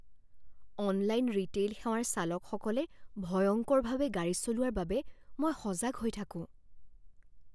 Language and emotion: Assamese, fearful